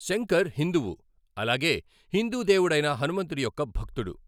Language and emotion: Telugu, neutral